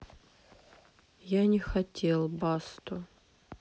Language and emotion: Russian, sad